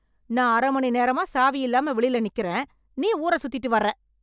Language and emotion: Tamil, angry